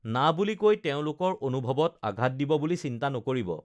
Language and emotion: Assamese, neutral